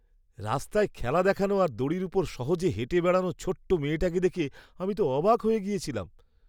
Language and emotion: Bengali, surprised